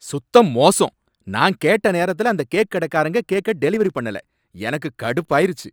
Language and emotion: Tamil, angry